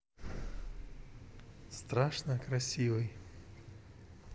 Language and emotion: Russian, neutral